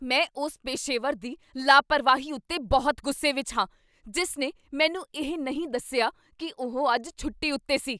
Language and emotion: Punjabi, angry